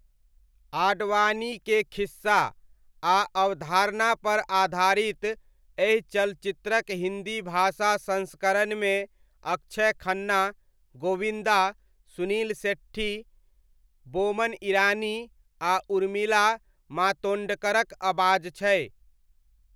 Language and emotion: Maithili, neutral